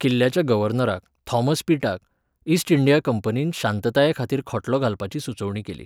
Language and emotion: Goan Konkani, neutral